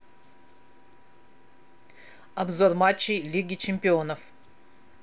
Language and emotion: Russian, neutral